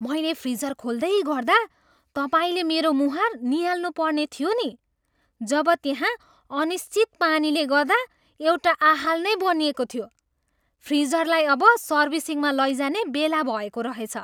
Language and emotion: Nepali, surprised